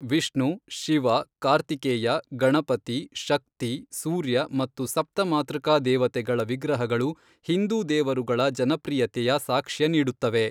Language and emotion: Kannada, neutral